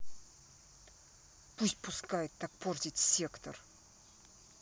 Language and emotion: Russian, angry